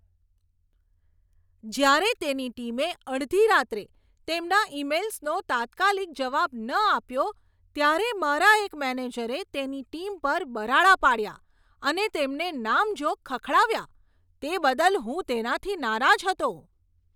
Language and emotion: Gujarati, angry